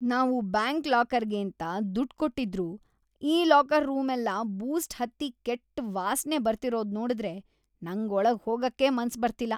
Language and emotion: Kannada, disgusted